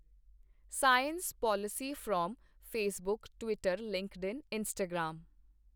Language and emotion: Punjabi, neutral